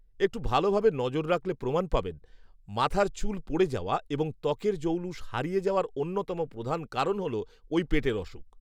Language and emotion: Bengali, neutral